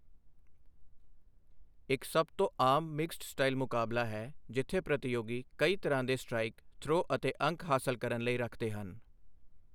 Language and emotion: Punjabi, neutral